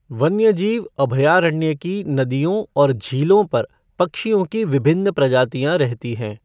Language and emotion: Hindi, neutral